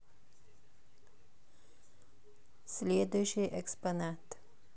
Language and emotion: Russian, neutral